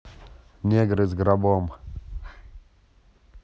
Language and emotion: Russian, neutral